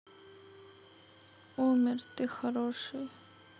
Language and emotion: Russian, sad